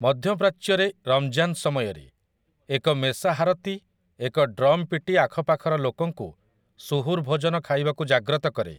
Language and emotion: Odia, neutral